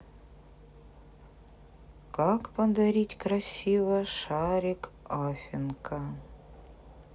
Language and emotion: Russian, sad